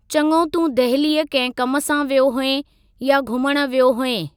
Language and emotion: Sindhi, neutral